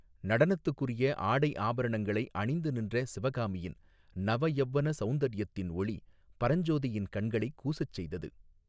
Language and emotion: Tamil, neutral